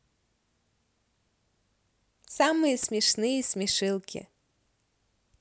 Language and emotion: Russian, positive